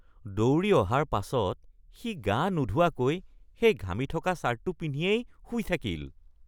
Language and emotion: Assamese, disgusted